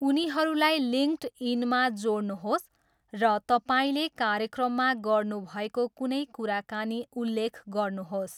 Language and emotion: Nepali, neutral